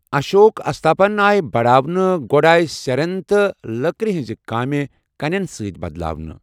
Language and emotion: Kashmiri, neutral